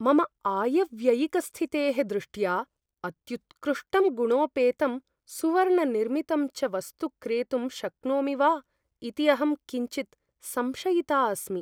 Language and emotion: Sanskrit, fearful